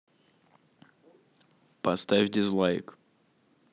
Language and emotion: Russian, neutral